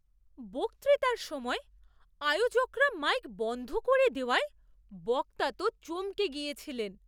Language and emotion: Bengali, surprised